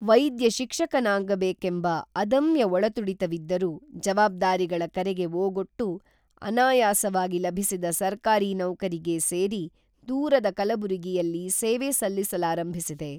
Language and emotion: Kannada, neutral